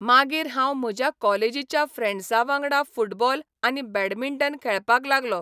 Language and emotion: Goan Konkani, neutral